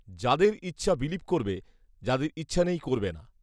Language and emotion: Bengali, neutral